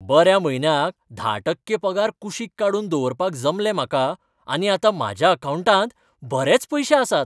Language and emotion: Goan Konkani, happy